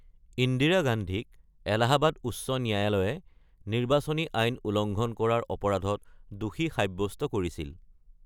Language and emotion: Assamese, neutral